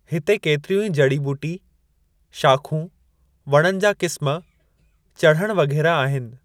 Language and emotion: Sindhi, neutral